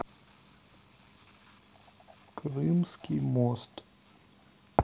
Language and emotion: Russian, sad